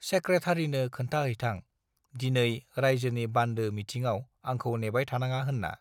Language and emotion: Bodo, neutral